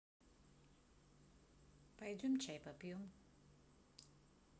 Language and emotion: Russian, neutral